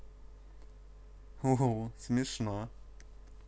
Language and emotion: Russian, positive